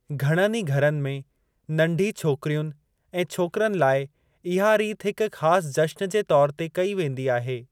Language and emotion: Sindhi, neutral